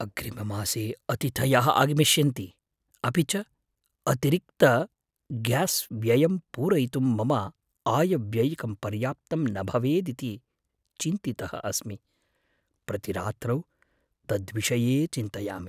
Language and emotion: Sanskrit, fearful